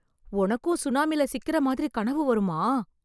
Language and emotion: Tamil, surprised